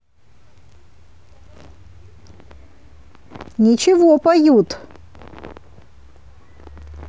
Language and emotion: Russian, positive